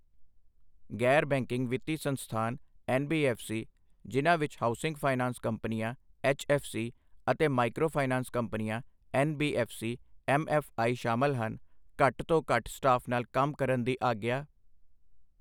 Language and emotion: Punjabi, neutral